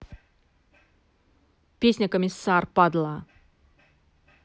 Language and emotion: Russian, angry